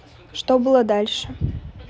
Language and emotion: Russian, neutral